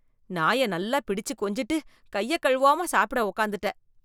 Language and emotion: Tamil, disgusted